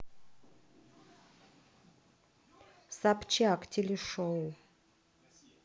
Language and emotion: Russian, neutral